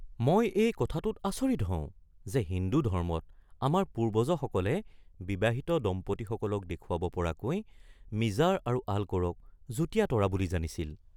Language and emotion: Assamese, surprised